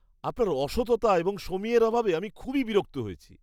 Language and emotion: Bengali, disgusted